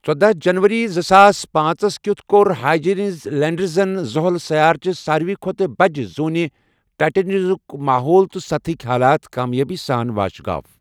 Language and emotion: Kashmiri, neutral